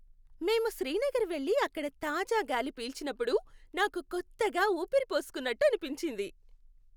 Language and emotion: Telugu, happy